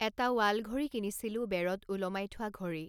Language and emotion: Assamese, neutral